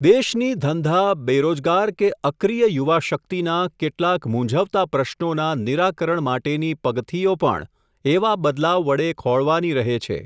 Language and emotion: Gujarati, neutral